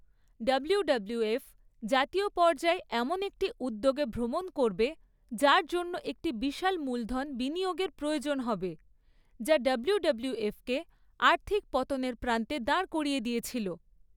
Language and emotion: Bengali, neutral